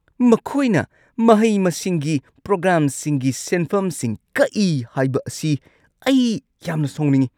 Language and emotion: Manipuri, angry